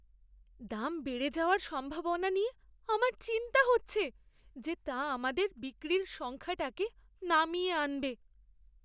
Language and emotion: Bengali, fearful